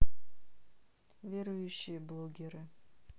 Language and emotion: Russian, neutral